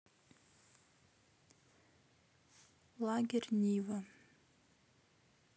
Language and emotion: Russian, neutral